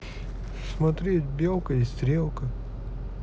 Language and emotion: Russian, sad